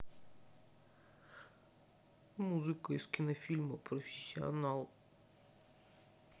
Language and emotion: Russian, sad